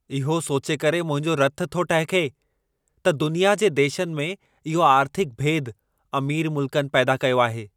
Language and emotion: Sindhi, angry